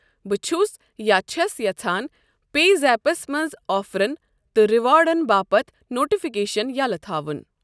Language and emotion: Kashmiri, neutral